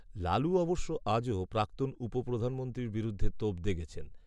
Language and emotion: Bengali, neutral